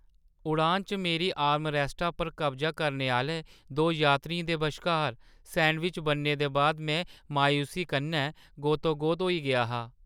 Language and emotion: Dogri, sad